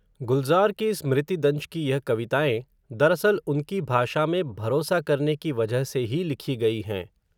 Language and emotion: Hindi, neutral